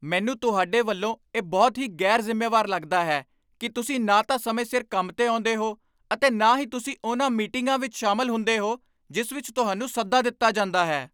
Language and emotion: Punjabi, angry